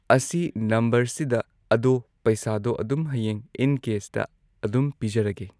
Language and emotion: Manipuri, neutral